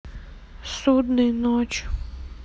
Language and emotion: Russian, sad